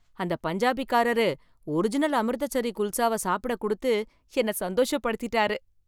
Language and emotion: Tamil, happy